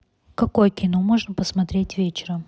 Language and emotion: Russian, neutral